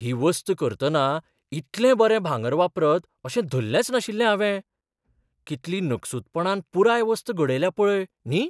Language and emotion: Goan Konkani, surprised